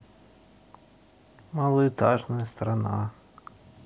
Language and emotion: Russian, neutral